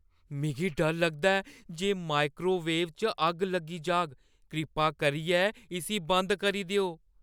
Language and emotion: Dogri, fearful